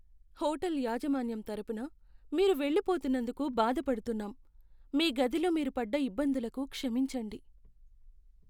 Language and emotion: Telugu, sad